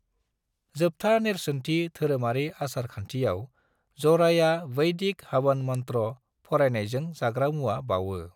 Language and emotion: Bodo, neutral